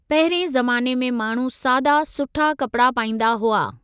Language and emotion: Sindhi, neutral